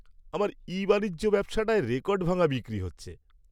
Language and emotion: Bengali, happy